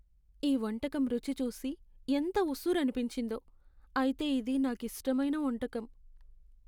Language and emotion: Telugu, sad